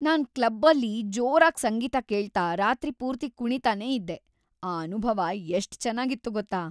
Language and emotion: Kannada, happy